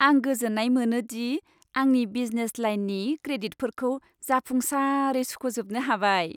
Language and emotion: Bodo, happy